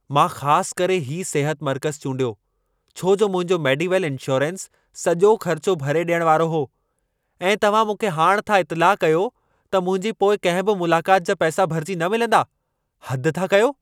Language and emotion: Sindhi, angry